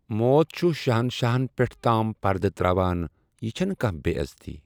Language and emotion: Kashmiri, neutral